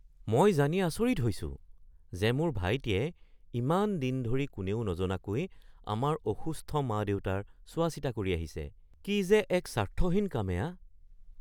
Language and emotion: Assamese, surprised